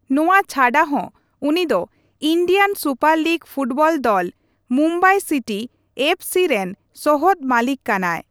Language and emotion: Santali, neutral